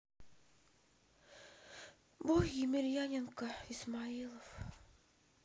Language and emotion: Russian, sad